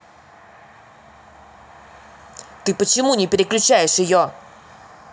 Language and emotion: Russian, angry